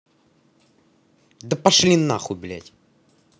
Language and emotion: Russian, angry